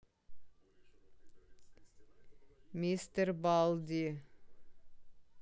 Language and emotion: Russian, neutral